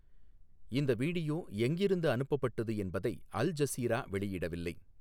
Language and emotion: Tamil, neutral